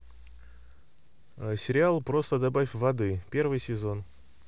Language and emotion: Russian, neutral